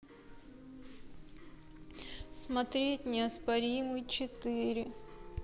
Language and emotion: Russian, sad